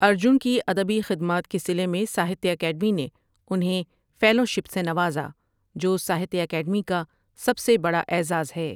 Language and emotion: Urdu, neutral